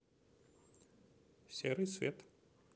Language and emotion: Russian, neutral